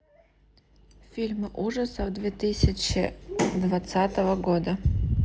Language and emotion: Russian, neutral